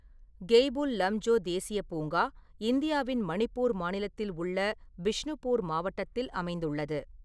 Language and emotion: Tamil, neutral